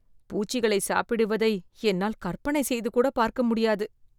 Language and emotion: Tamil, disgusted